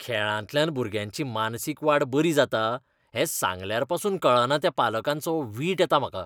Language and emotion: Goan Konkani, disgusted